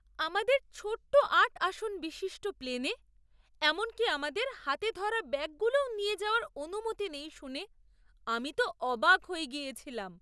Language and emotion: Bengali, surprised